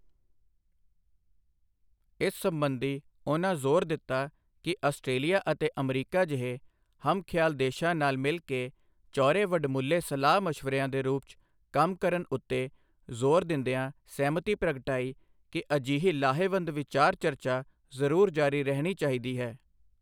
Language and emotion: Punjabi, neutral